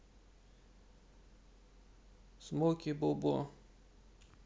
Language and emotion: Russian, sad